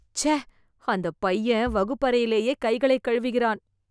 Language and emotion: Tamil, disgusted